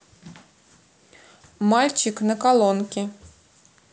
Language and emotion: Russian, neutral